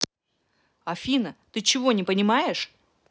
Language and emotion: Russian, angry